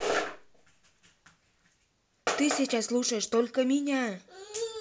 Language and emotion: Russian, angry